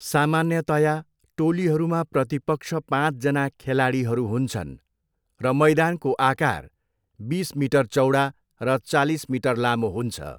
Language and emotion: Nepali, neutral